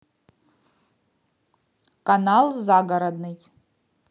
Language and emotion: Russian, neutral